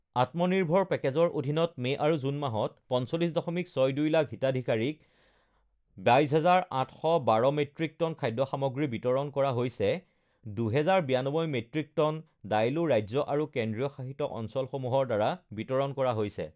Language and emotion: Assamese, neutral